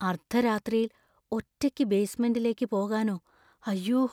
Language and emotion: Malayalam, fearful